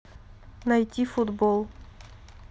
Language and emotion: Russian, neutral